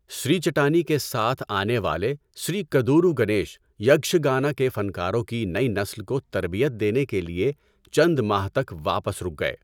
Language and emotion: Urdu, neutral